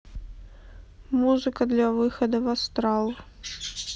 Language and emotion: Russian, sad